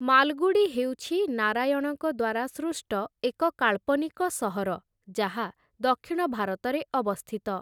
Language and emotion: Odia, neutral